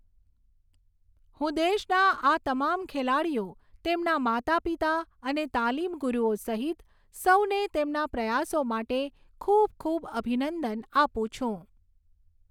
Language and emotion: Gujarati, neutral